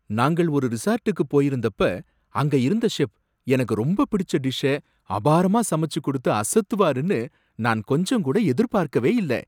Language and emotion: Tamil, surprised